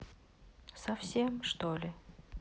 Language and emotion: Russian, sad